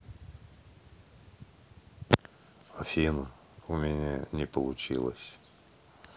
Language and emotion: Russian, sad